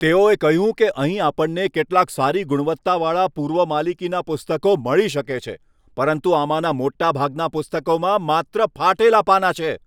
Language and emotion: Gujarati, angry